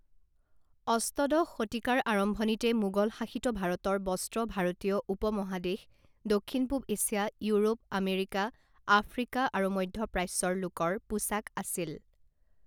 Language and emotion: Assamese, neutral